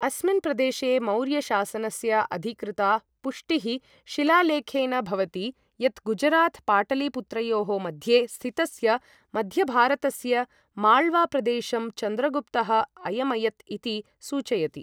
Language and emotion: Sanskrit, neutral